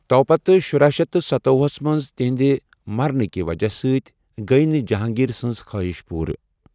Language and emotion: Kashmiri, neutral